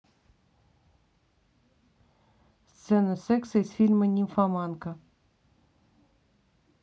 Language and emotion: Russian, neutral